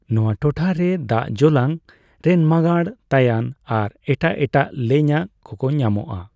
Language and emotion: Santali, neutral